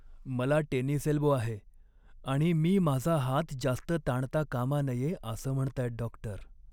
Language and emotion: Marathi, sad